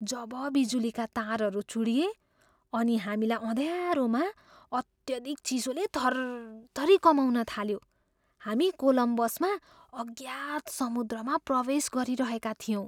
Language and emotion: Nepali, fearful